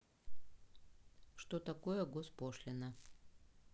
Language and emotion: Russian, neutral